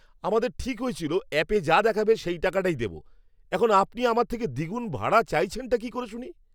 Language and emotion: Bengali, angry